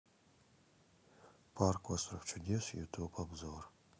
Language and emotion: Russian, neutral